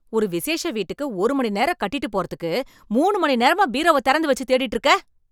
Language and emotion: Tamil, angry